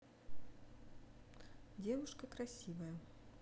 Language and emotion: Russian, neutral